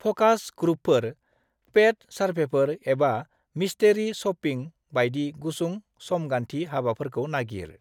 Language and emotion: Bodo, neutral